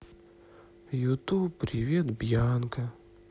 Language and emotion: Russian, sad